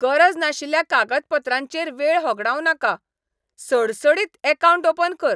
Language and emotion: Goan Konkani, angry